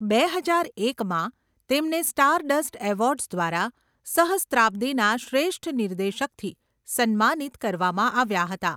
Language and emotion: Gujarati, neutral